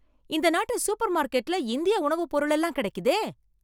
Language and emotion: Tamil, surprised